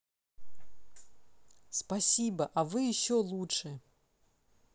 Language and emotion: Russian, positive